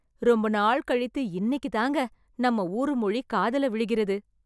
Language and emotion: Tamil, happy